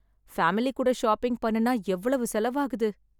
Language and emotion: Tamil, sad